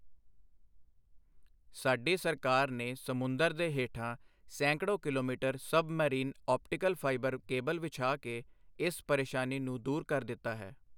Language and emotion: Punjabi, neutral